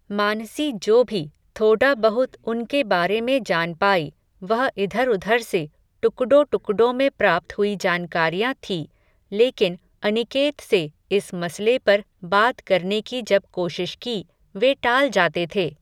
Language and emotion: Hindi, neutral